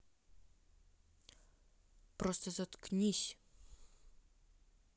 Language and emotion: Russian, angry